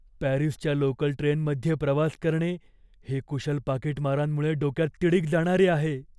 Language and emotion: Marathi, fearful